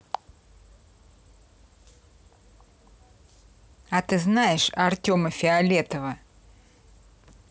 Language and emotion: Russian, neutral